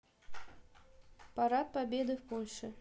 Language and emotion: Russian, neutral